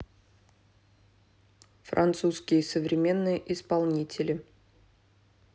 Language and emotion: Russian, neutral